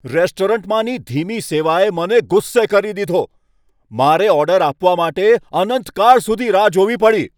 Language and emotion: Gujarati, angry